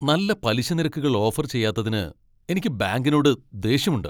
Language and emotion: Malayalam, angry